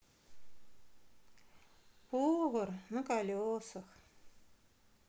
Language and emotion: Russian, sad